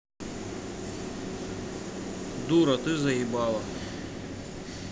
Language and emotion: Russian, neutral